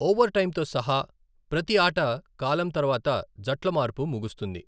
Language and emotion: Telugu, neutral